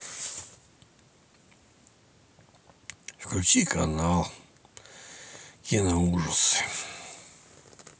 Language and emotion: Russian, sad